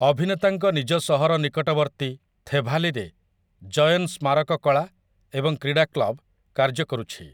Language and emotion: Odia, neutral